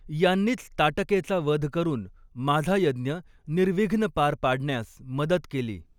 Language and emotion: Marathi, neutral